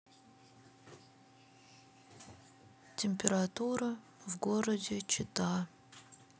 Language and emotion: Russian, sad